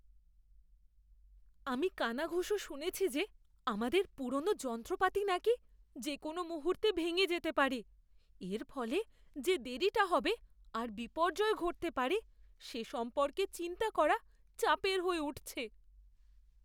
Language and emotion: Bengali, fearful